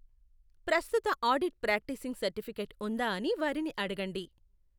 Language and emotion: Telugu, neutral